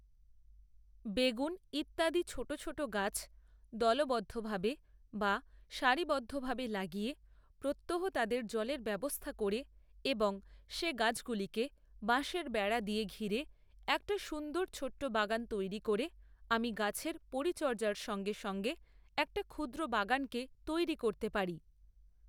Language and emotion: Bengali, neutral